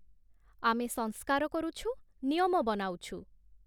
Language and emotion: Odia, neutral